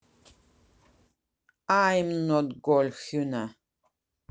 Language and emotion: Russian, neutral